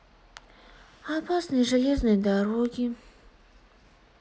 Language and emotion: Russian, sad